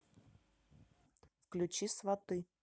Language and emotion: Russian, neutral